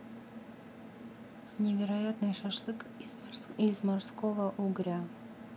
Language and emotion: Russian, neutral